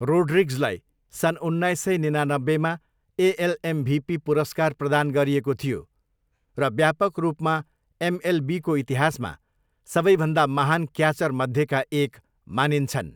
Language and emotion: Nepali, neutral